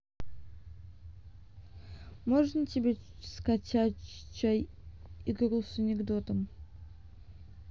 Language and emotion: Russian, neutral